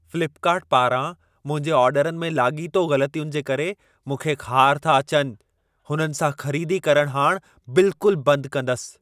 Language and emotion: Sindhi, angry